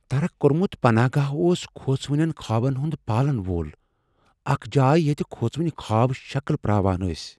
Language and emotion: Kashmiri, fearful